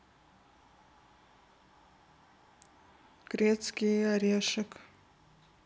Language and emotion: Russian, neutral